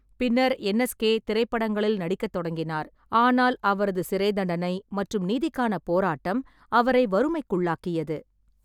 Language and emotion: Tamil, neutral